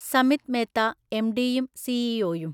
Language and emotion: Malayalam, neutral